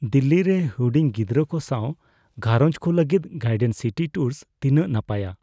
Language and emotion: Santali, fearful